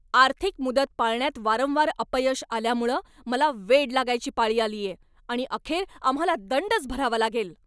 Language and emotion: Marathi, angry